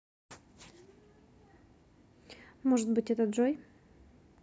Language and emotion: Russian, neutral